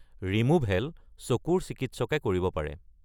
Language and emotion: Assamese, neutral